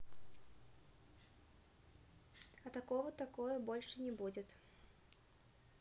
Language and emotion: Russian, neutral